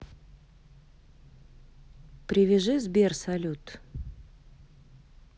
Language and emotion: Russian, neutral